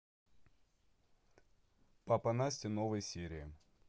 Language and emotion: Russian, neutral